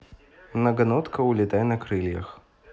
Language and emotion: Russian, neutral